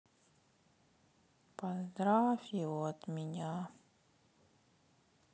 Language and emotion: Russian, sad